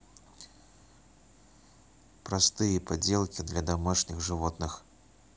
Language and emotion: Russian, neutral